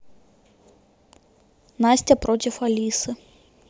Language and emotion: Russian, neutral